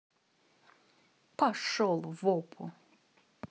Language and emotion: Russian, angry